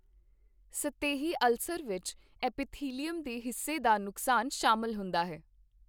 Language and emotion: Punjabi, neutral